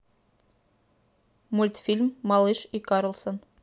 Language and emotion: Russian, neutral